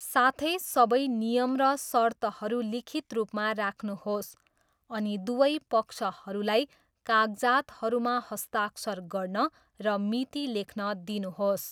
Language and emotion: Nepali, neutral